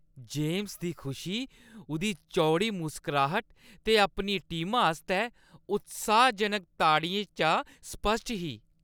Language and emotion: Dogri, happy